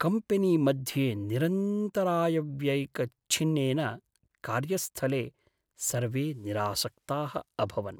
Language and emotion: Sanskrit, sad